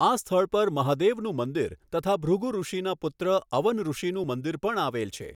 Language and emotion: Gujarati, neutral